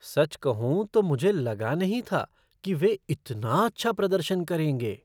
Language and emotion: Hindi, surprised